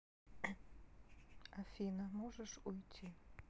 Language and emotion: Russian, neutral